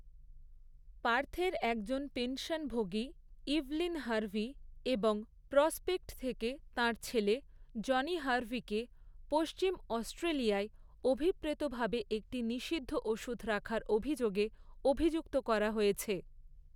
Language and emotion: Bengali, neutral